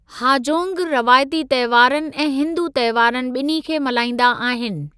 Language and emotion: Sindhi, neutral